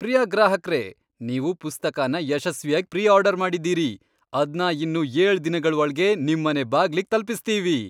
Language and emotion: Kannada, happy